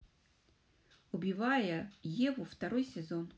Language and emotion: Russian, neutral